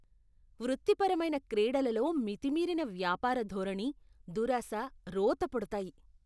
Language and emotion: Telugu, disgusted